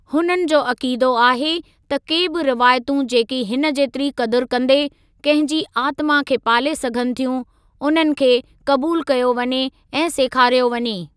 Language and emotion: Sindhi, neutral